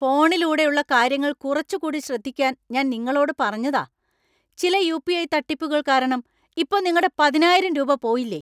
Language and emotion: Malayalam, angry